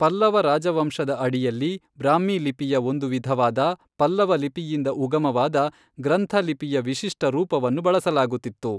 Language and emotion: Kannada, neutral